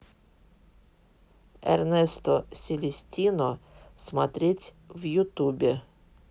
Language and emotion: Russian, neutral